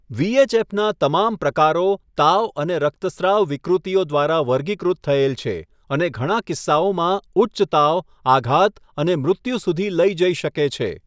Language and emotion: Gujarati, neutral